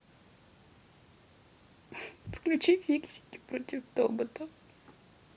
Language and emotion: Russian, sad